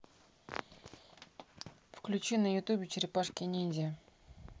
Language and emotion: Russian, neutral